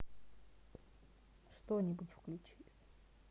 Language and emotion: Russian, neutral